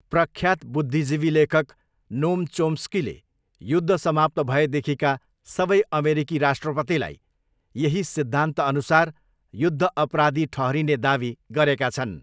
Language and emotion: Nepali, neutral